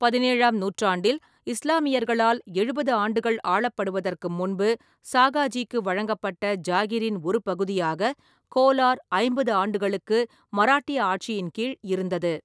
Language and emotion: Tamil, neutral